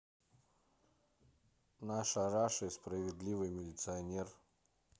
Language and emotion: Russian, neutral